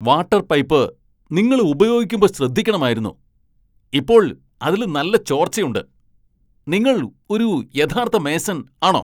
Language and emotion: Malayalam, angry